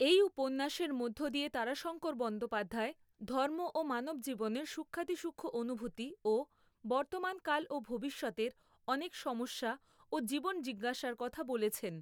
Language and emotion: Bengali, neutral